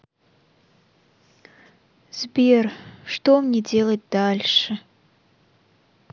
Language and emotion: Russian, sad